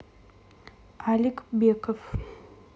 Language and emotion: Russian, neutral